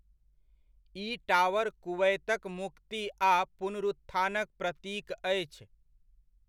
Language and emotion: Maithili, neutral